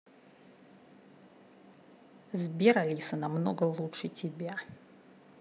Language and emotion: Russian, neutral